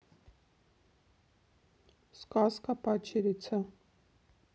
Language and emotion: Russian, neutral